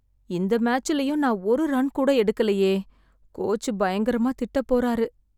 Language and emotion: Tamil, sad